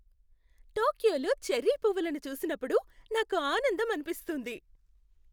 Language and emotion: Telugu, happy